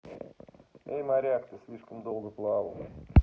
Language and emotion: Russian, neutral